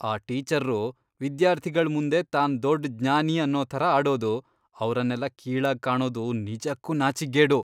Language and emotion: Kannada, disgusted